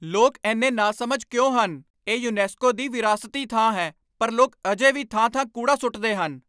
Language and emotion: Punjabi, angry